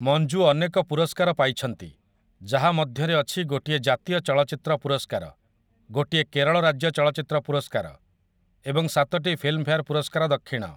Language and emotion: Odia, neutral